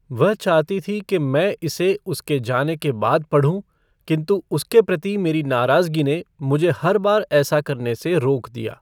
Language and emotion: Hindi, neutral